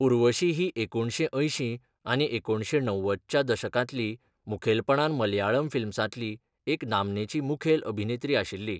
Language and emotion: Goan Konkani, neutral